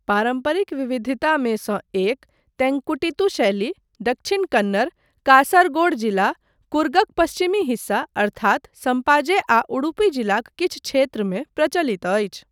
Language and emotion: Maithili, neutral